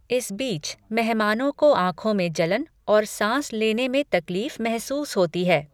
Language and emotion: Hindi, neutral